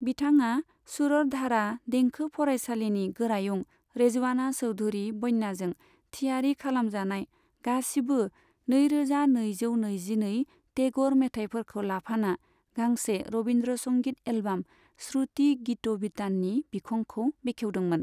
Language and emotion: Bodo, neutral